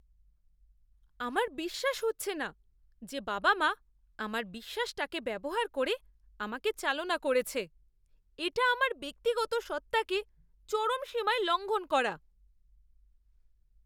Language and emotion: Bengali, disgusted